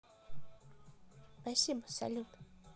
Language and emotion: Russian, sad